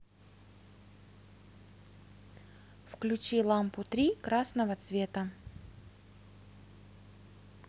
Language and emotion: Russian, neutral